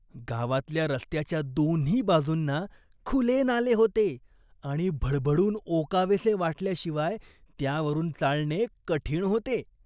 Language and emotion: Marathi, disgusted